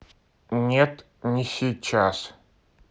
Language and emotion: Russian, neutral